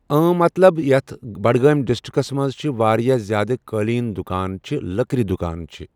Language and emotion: Kashmiri, neutral